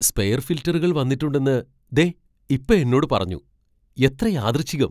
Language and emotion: Malayalam, surprised